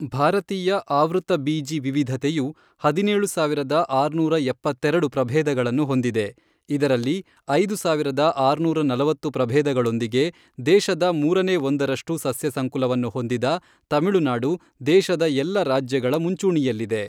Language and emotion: Kannada, neutral